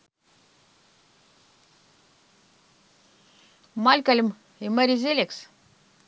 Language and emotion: Russian, neutral